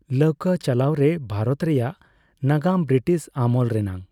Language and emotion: Santali, neutral